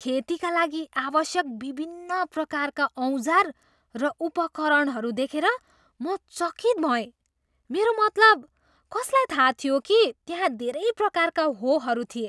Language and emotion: Nepali, surprised